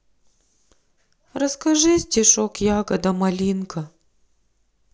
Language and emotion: Russian, sad